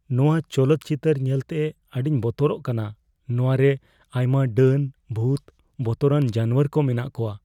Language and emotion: Santali, fearful